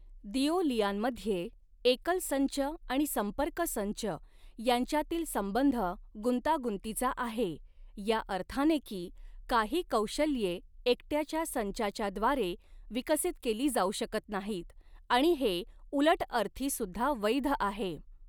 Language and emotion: Marathi, neutral